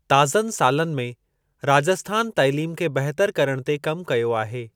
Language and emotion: Sindhi, neutral